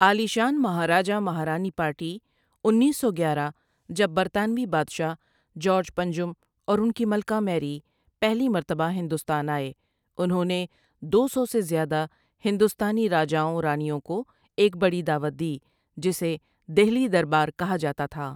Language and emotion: Urdu, neutral